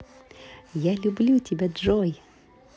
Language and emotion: Russian, positive